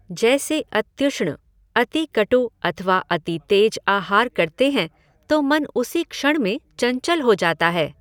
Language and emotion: Hindi, neutral